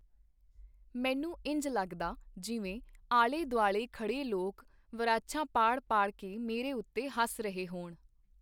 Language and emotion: Punjabi, neutral